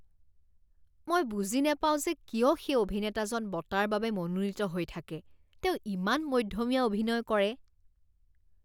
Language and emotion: Assamese, disgusted